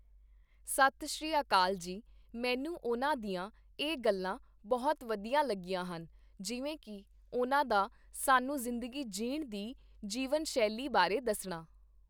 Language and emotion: Punjabi, neutral